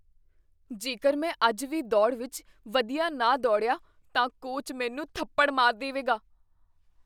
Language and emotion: Punjabi, fearful